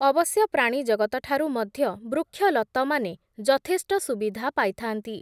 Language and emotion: Odia, neutral